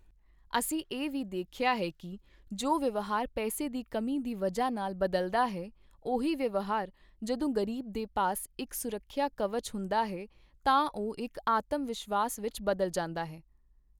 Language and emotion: Punjabi, neutral